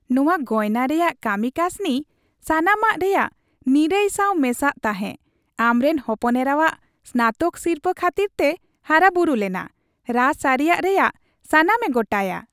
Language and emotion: Santali, happy